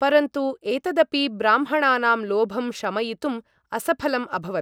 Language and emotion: Sanskrit, neutral